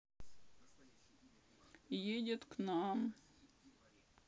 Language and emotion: Russian, sad